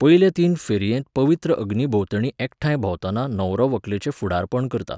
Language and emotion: Goan Konkani, neutral